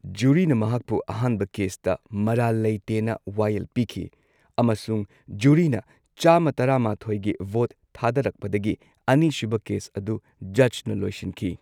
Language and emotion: Manipuri, neutral